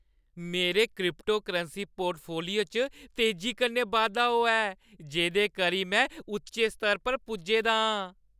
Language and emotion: Dogri, happy